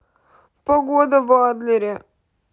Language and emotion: Russian, sad